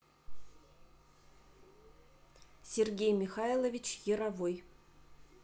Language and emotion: Russian, neutral